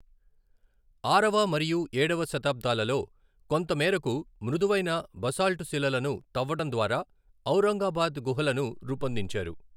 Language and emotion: Telugu, neutral